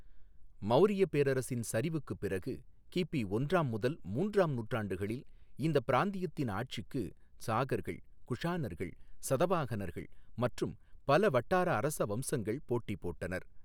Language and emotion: Tamil, neutral